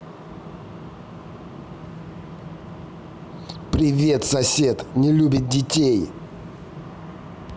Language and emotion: Russian, angry